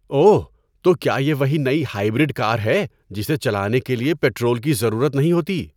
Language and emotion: Urdu, surprised